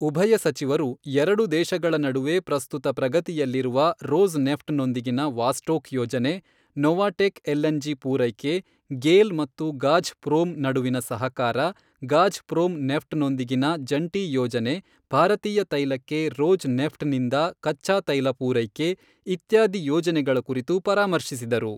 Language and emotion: Kannada, neutral